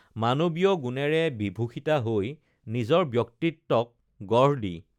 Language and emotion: Assamese, neutral